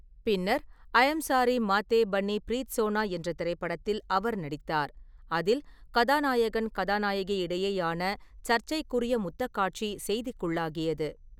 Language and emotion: Tamil, neutral